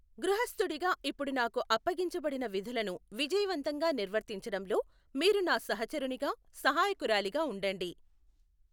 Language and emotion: Telugu, neutral